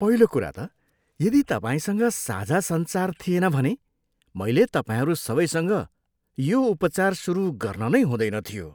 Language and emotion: Nepali, disgusted